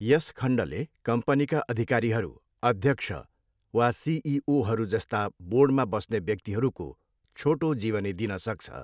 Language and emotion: Nepali, neutral